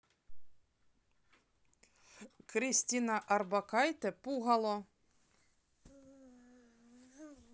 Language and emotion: Russian, neutral